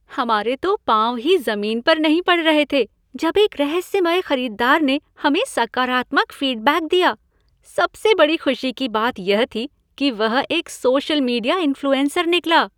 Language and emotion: Hindi, happy